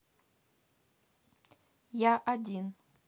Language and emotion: Russian, neutral